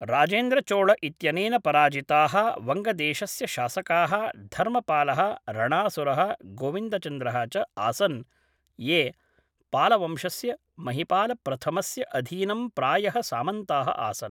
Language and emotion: Sanskrit, neutral